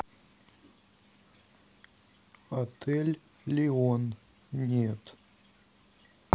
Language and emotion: Russian, neutral